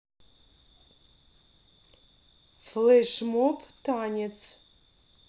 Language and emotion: Russian, neutral